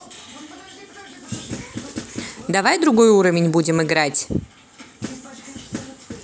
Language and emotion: Russian, neutral